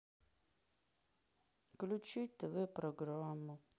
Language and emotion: Russian, sad